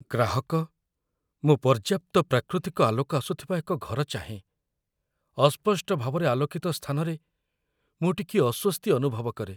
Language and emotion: Odia, fearful